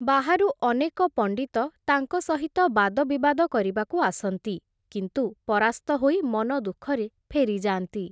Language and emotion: Odia, neutral